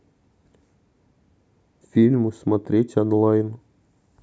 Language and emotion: Russian, neutral